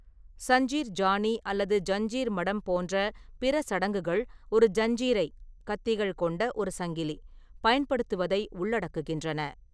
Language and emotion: Tamil, neutral